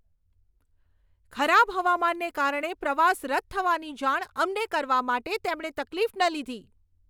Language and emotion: Gujarati, angry